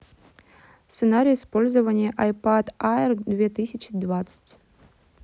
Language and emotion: Russian, neutral